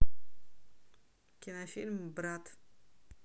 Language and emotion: Russian, neutral